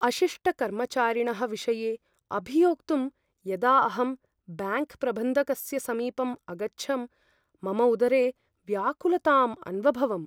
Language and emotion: Sanskrit, fearful